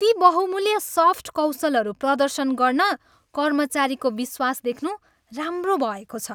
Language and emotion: Nepali, happy